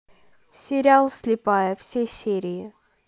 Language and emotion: Russian, neutral